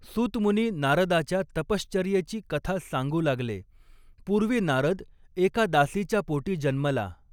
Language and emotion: Marathi, neutral